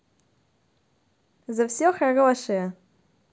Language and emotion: Russian, positive